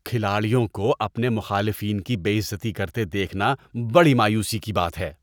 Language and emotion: Urdu, disgusted